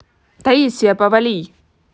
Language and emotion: Russian, angry